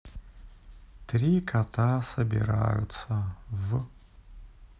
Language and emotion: Russian, sad